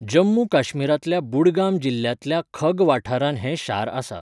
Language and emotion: Goan Konkani, neutral